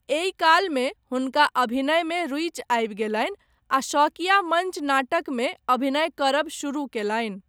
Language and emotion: Maithili, neutral